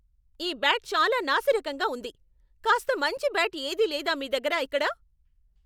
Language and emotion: Telugu, angry